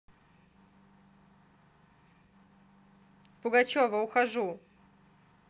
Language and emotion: Russian, neutral